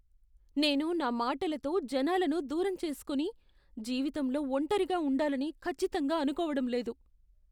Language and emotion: Telugu, fearful